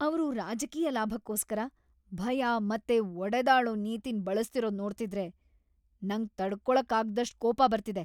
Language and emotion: Kannada, angry